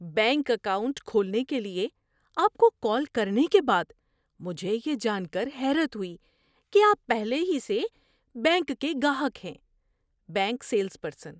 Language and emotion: Urdu, surprised